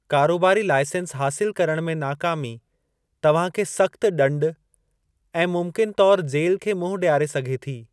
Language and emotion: Sindhi, neutral